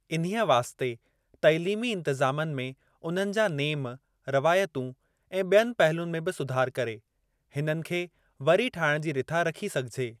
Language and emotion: Sindhi, neutral